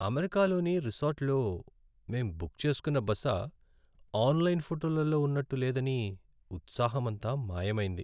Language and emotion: Telugu, sad